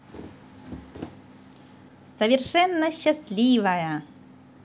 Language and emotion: Russian, positive